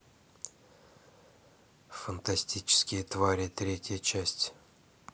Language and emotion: Russian, neutral